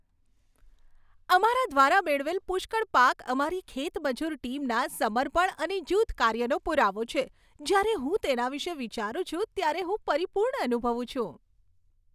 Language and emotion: Gujarati, happy